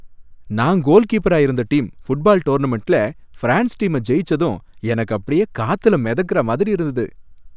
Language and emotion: Tamil, happy